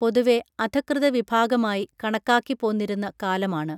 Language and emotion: Malayalam, neutral